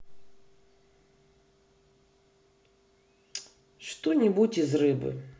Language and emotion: Russian, neutral